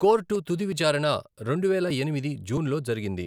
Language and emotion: Telugu, neutral